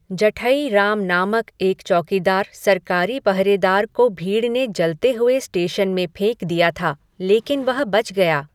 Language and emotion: Hindi, neutral